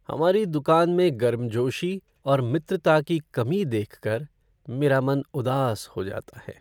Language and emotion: Hindi, sad